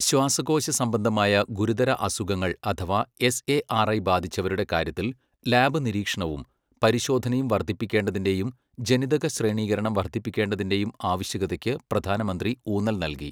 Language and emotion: Malayalam, neutral